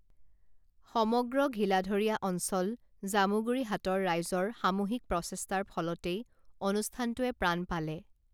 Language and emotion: Assamese, neutral